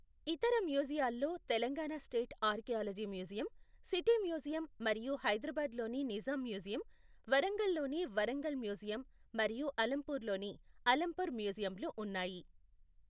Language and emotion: Telugu, neutral